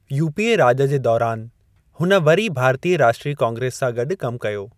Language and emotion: Sindhi, neutral